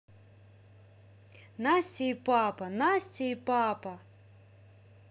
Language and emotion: Russian, positive